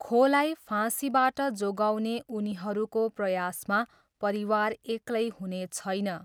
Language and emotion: Nepali, neutral